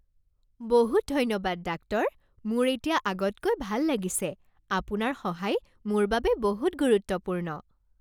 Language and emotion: Assamese, happy